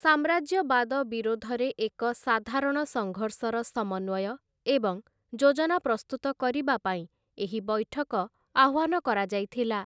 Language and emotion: Odia, neutral